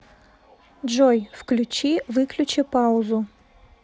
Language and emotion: Russian, neutral